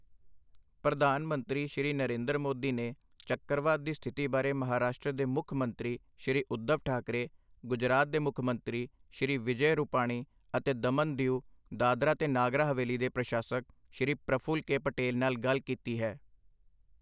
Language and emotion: Punjabi, neutral